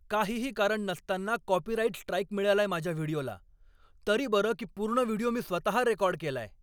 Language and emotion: Marathi, angry